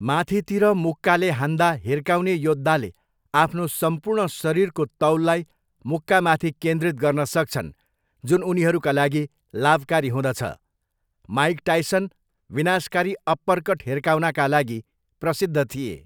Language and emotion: Nepali, neutral